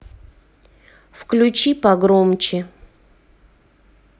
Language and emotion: Russian, neutral